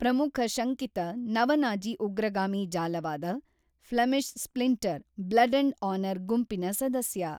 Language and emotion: Kannada, neutral